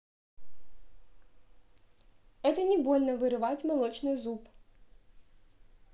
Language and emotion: Russian, neutral